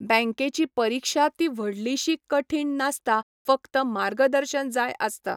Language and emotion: Goan Konkani, neutral